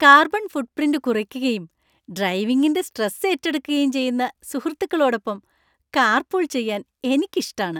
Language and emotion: Malayalam, happy